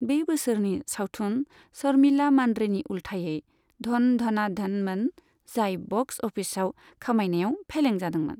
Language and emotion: Bodo, neutral